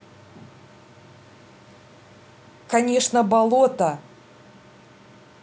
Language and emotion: Russian, angry